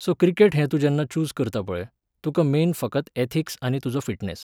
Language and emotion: Goan Konkani, neutral